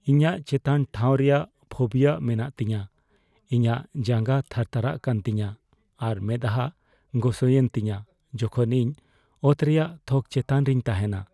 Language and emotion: Santali, fearful